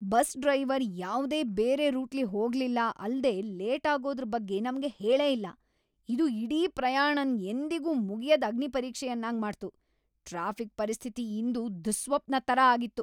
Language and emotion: Kannada, angry